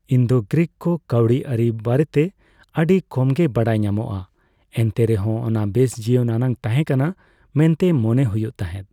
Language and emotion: Santali, neutral